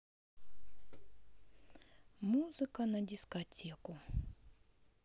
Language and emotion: Russian, sad